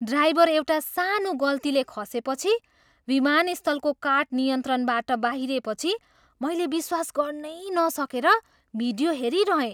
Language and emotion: Nepali, surprised